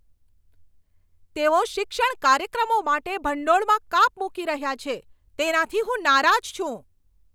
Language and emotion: Gujarati, angry